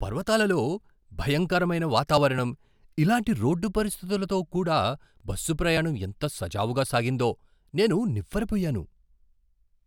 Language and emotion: Telugu, surprised